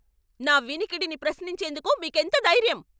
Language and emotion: Telugu, angry